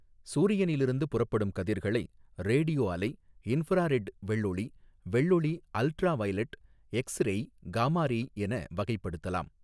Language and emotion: Tamil, neutral